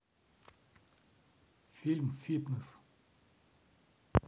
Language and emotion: Russian, neutral